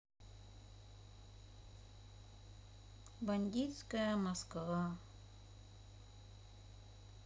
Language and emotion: Russian, sad